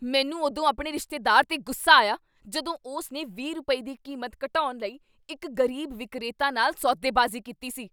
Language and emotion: Punjabi, angry